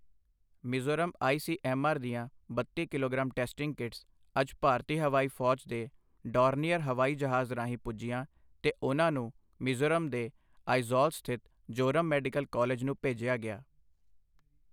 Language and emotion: Punjabi, neutral